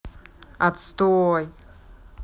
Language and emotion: Russian, neutral